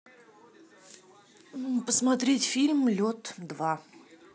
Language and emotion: Russian, neutral